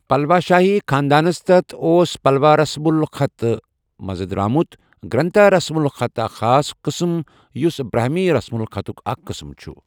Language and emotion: Kashmiri, neutral